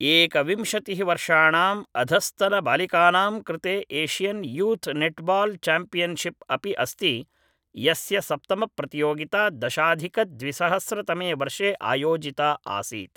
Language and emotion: Sanskrit, neutral